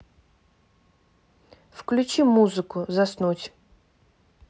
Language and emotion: Russian, neutral